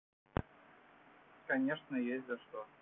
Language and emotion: Russian, neutral